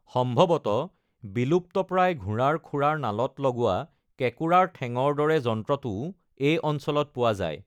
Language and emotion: Assamese, neutral